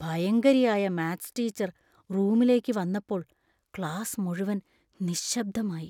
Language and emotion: Malayalam, fearful